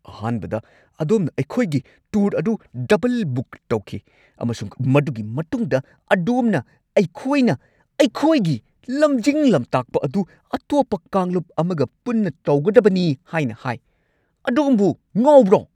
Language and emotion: Manipuri, angry